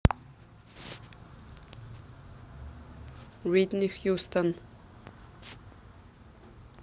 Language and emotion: Russian, neutral